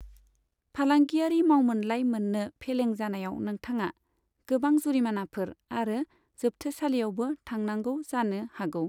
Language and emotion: Bodo, neutral